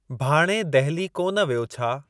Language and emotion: Sindhi, neutral